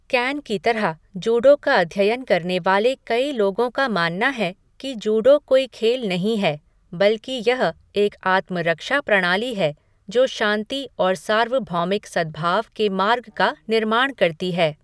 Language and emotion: Hindi, neutral